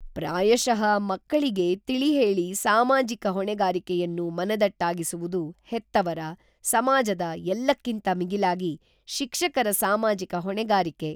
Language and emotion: Kannada, neutral